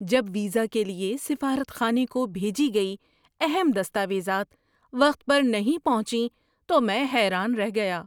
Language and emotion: Urdu, surprised